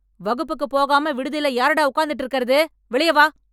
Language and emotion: Tamil, angry